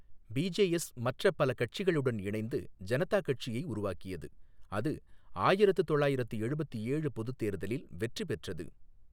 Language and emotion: Tamil, neutral